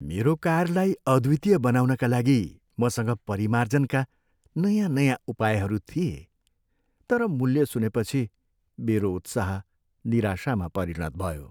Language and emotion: Nepali, sad